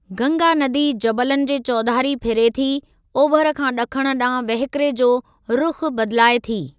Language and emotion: Sindhi, neutral